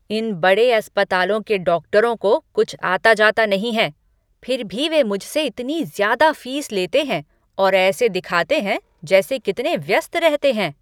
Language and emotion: Hindi, angry